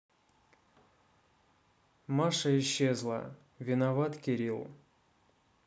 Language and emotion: Russian, neutral